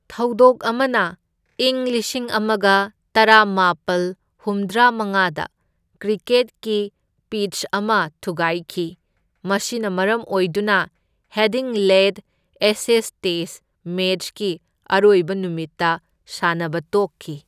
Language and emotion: Manipuri, neutral